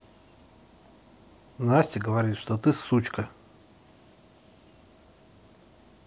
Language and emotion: Russian, neutral